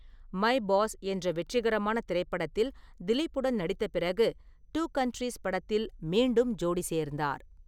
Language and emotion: Tamil, neutral